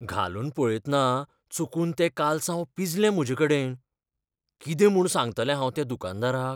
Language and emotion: Goan Konkani, fearful